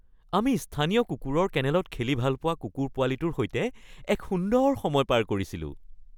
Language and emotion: Assamese, happy